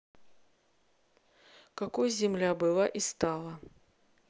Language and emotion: Russian, neutral